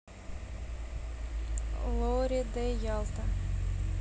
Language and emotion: Russian, neutral